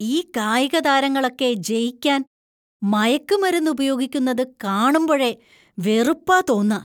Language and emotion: Malayalam, disgusted